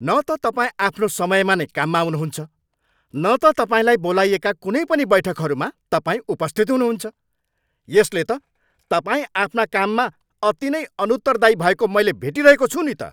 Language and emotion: Nepali, angry